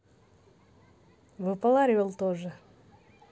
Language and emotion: Russian, positive